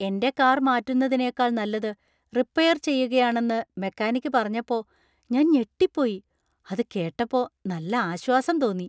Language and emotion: Malayalam, surprised